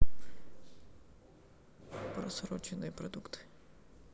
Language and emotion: Russian, neutral